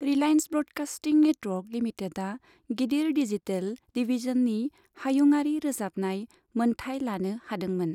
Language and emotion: Bodo, neutral